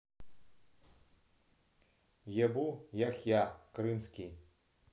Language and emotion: Russian, neutral